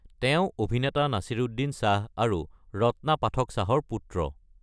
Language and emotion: Assamese, neutral